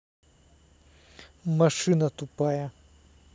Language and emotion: Russian, angry